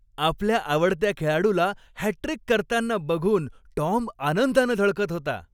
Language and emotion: Marathi, happy